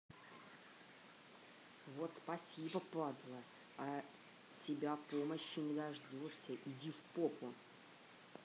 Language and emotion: Russian, angry